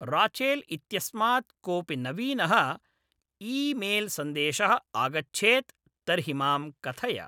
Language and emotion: Sanskrit, neutral